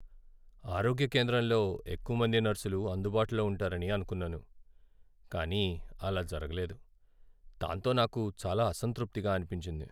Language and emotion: Telugu, sad